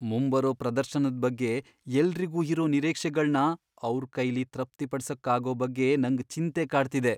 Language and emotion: Kannada, fearful